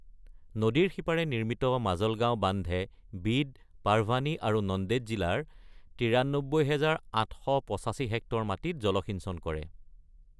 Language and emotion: Assamese, neutral